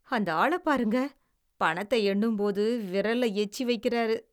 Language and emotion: Tamil, disgusted